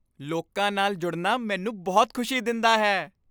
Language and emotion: Punjabi, happy